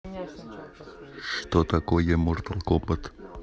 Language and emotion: Russian, neutral